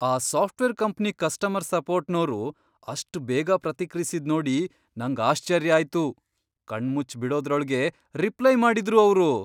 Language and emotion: Kannada, surprised